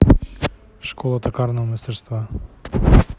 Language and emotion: Russian, neutral